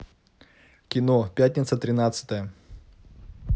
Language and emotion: Russian, neutral